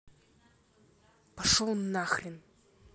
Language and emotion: Russian, angry